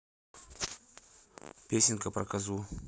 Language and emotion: Russian, neutral